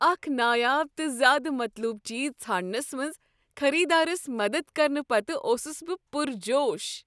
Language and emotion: Kashmiri, happy